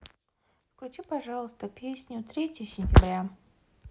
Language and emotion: Russian, neutral